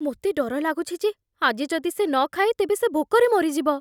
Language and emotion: Odia, fearful